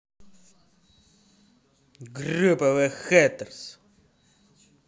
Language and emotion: Russian, angry